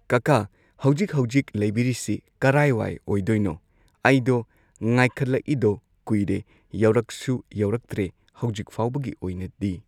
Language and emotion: Manipuri, neutral